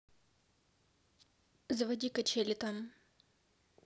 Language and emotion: Russian, neutral